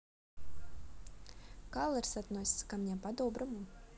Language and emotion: Russian, neutral